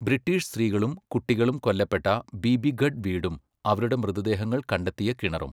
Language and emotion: Malayalam, neutral